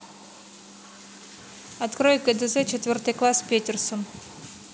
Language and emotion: Russian, neutral